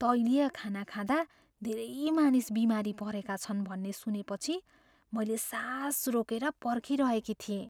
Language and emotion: Nepali, fearful